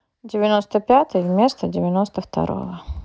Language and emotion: Russian, neutral